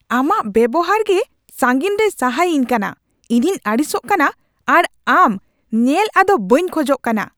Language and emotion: Santali, angry